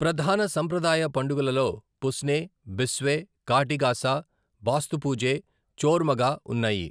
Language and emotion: Telugu, neutral